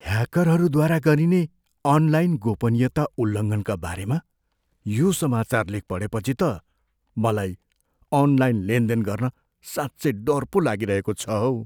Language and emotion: Nepali, fearful